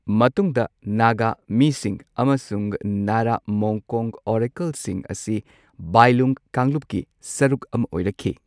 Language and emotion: Manipuri, neutral